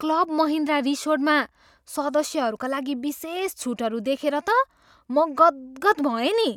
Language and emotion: Nepali, surprised